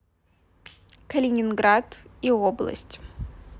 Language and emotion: Russian, neutral